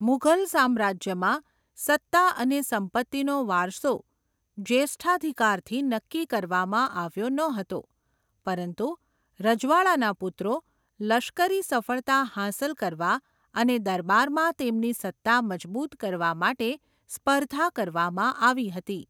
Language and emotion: Gujarati, neutral